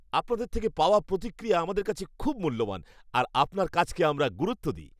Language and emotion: Bengali, happy